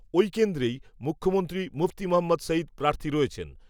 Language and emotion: Bengali, neutral